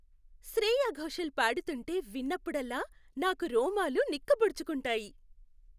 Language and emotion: Telugu, happy